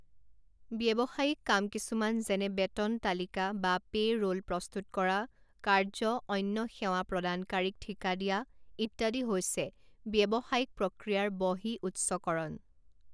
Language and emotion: Assamese, neutral